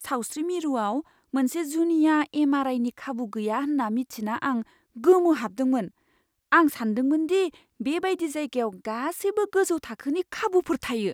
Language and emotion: Bodo, surprised